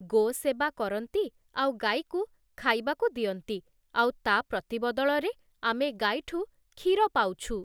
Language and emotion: Odia, neutral